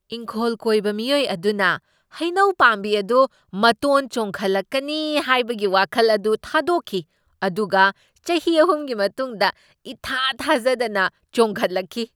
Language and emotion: Manipuri, surprised